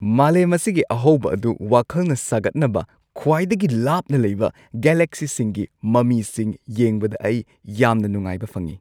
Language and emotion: Manipuri, happy